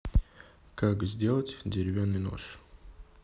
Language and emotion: Russian, neutral